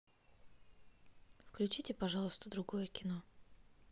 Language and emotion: Russian, neutral